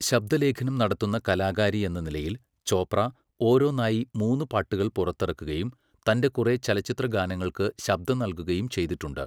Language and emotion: Malayalam, neutral